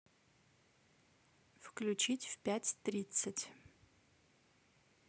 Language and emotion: Russian, neutral